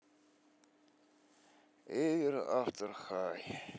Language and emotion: Russian, sad